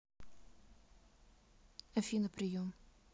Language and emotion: Russian, neutral